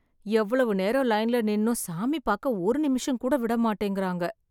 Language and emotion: Tamil, sad